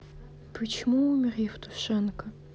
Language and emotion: Russian, sad